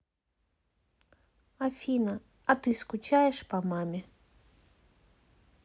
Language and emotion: Russian, sad